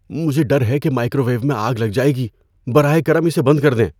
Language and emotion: Urdu, fearful